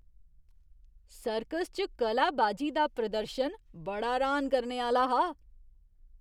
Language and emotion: Dogri, surprised